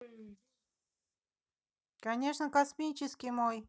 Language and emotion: Russian, positive